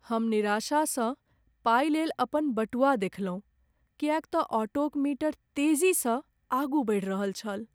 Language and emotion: Maithili, sad